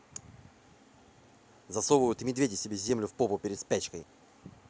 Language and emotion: Russian, angry